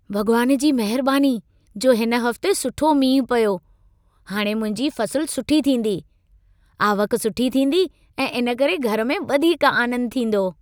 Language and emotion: Sindhi, happy